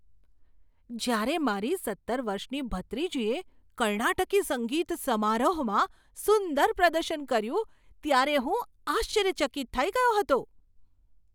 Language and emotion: Gujarati, surprised